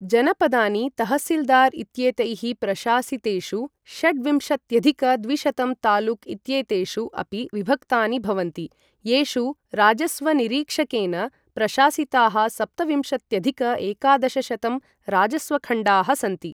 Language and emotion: Sanskrit, neutral